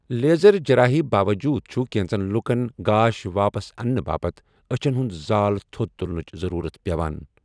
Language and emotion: Kashmiri, neutral